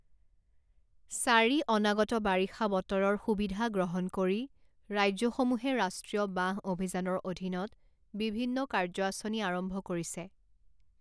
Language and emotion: Assamese, neutral